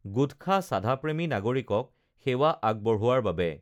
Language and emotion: Assamese, neutral